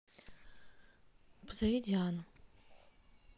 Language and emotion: Russian, neutral